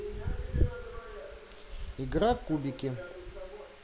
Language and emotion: Russian, neutral